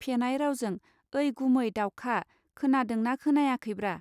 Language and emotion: Bodo, neutral